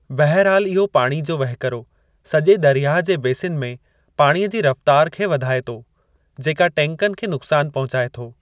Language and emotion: Sindhi, neutral